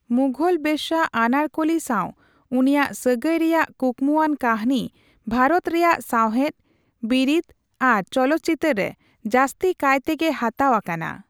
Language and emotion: Santali, neutral